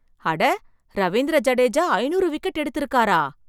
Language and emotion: Tamil, surprised